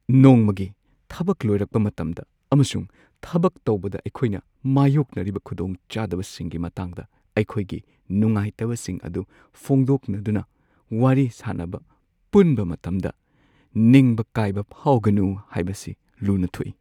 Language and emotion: Manipuri, sad